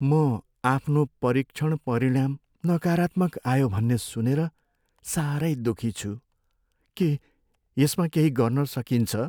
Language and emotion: Nepali, sad